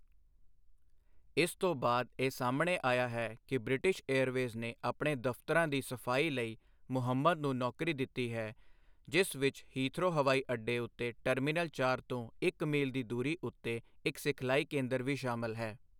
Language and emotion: Punjabi, neutral